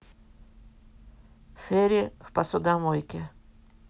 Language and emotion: Russian, neutral